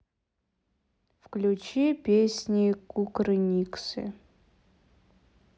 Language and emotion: Russian, sad